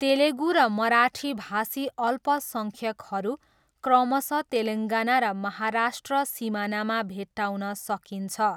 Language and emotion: Nepali, neutral